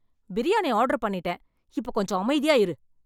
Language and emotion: Tamil, angry